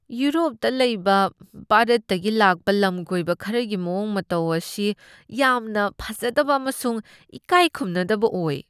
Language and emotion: Manipuri, disgusted